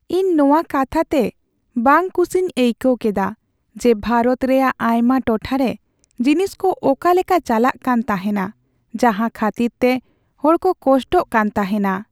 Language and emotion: Santali, sad